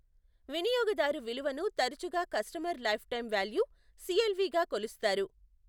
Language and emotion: Telugu, neutral